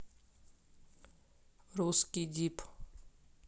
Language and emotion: Russian, neutral